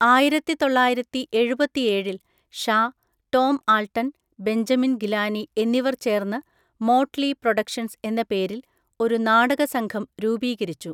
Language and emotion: Malayalam, neutral